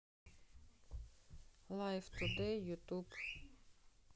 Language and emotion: Russian, neutral